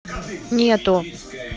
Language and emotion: Russian, neutral